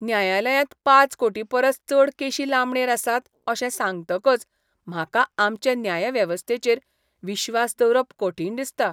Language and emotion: Goan Konkani, disgusted